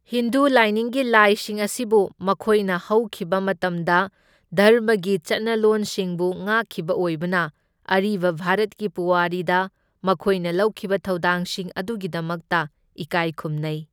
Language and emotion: Manipuri, neutral